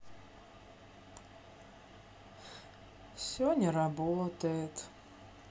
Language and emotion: Russian, sad